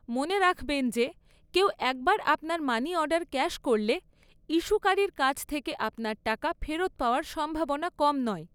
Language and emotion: Bengali, neutral